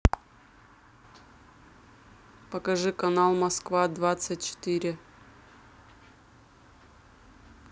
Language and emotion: Russian, neutral